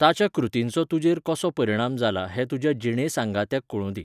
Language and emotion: Goan Konkani, neutral